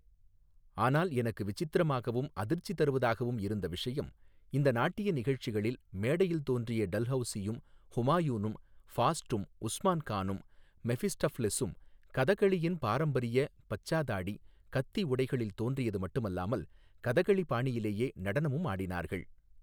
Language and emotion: Tamil, neutral